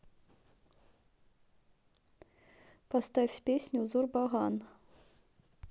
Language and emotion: Russian, neutral